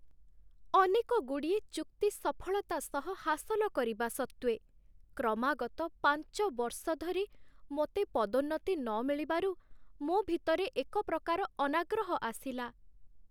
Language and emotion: Odia, sad